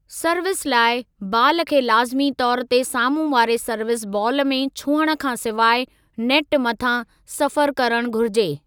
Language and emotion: Sindhi, neutral